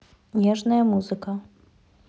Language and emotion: Russian, neutral